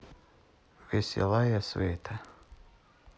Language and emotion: Russian, sad